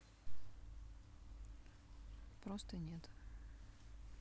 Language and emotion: Russian, neutral